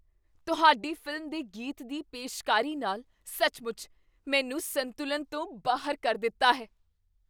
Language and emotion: Punjabi, surprised